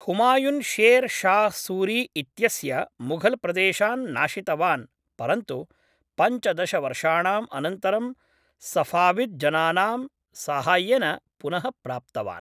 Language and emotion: Sanskrit, neutral